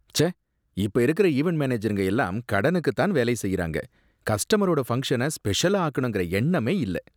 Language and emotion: Tamil, disgusted